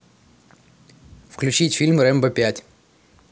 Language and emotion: Russian, positive